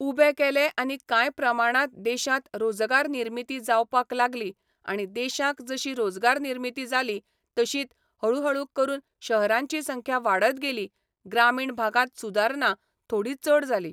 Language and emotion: Goan Konkani, neutral